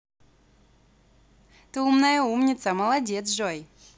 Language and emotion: Russian, positive